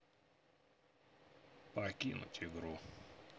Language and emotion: Russian, neutral